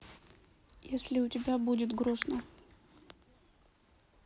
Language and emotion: Russian, sad